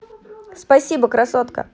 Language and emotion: Russian, positive